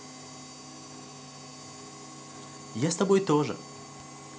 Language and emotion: Russian, positive